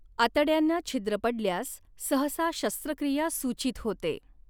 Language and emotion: Marathi, neutral